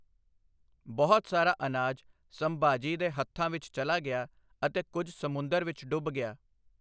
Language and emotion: Punjabi, neutral